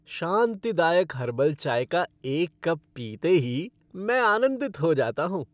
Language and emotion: Hindi, happy